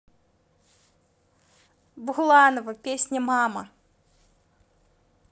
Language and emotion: Russian, neutral